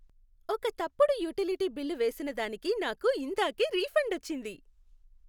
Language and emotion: Telugu, happy